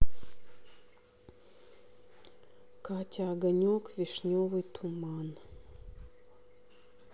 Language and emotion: Russian, sad